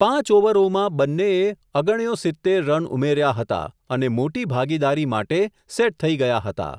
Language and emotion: Gujarati, neutral